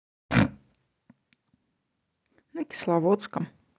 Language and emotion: Russian, neutral